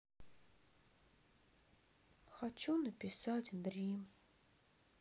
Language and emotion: Russian, sad